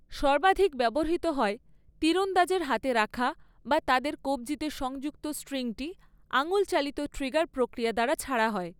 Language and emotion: Bengali, neutral